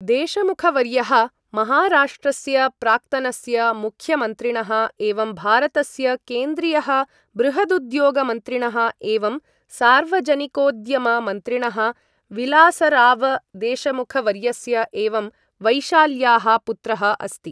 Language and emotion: Sanskrit, neutral